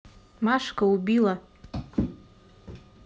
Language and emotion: Russian, neutral